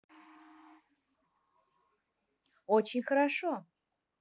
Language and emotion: Russian, positive